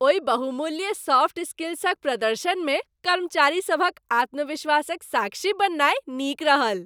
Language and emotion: Maithili, happy